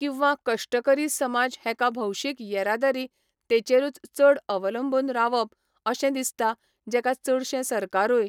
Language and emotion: Goan Konkani, neutral